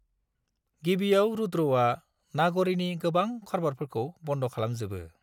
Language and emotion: Bodo, neutral